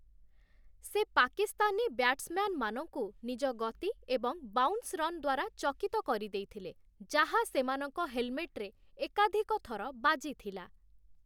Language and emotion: Odia, neutral